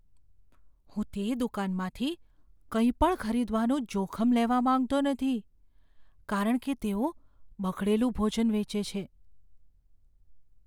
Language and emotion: Gujarati, fearful